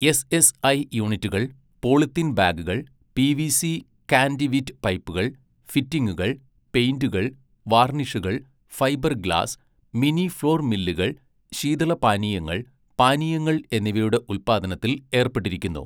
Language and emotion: Malayalam, neutral